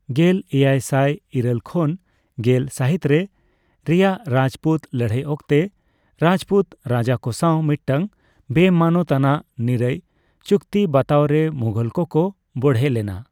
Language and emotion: Santali, neutral